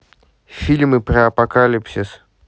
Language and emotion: Russian, neutral